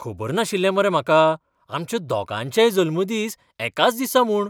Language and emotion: Goan Konkani, surprised